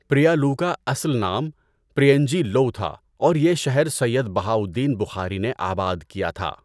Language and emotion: Urdu, neutral